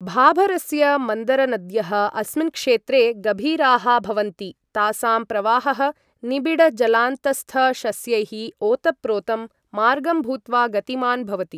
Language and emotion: Sanskrit, neutral